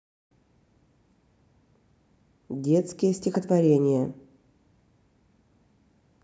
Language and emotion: Russian, neutral